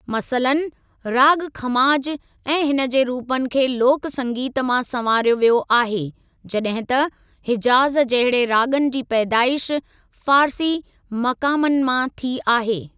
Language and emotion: Sindhi, neutral